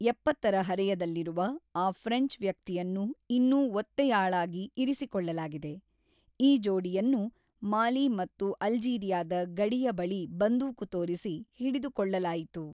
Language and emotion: Kannada, neutral